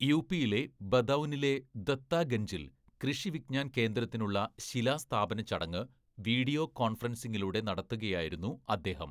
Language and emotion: Malayalam, neutral